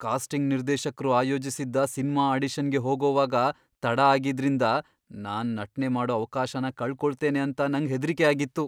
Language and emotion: Kannada, fearful